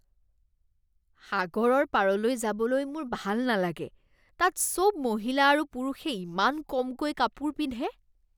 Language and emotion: Assamese, disgusted